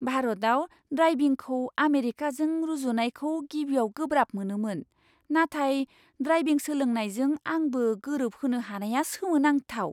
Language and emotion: Bodo, surprised